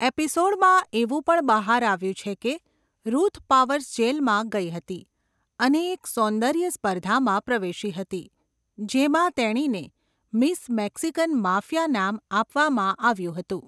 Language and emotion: Gujarati, neutral